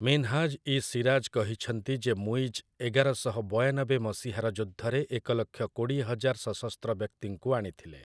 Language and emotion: Odia, neutral